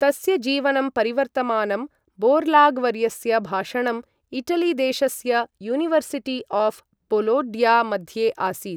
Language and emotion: Sanskrit, neutral